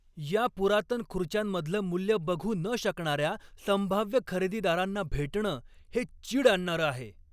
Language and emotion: Marathi, angry